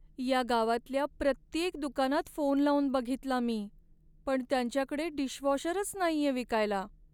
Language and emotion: Marathi, sad